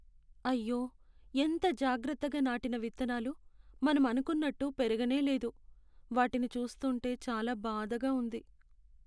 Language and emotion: Telugu, sad